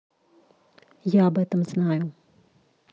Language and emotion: Russian, neutral